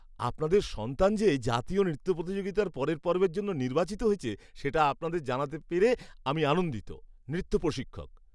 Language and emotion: Bengali, happy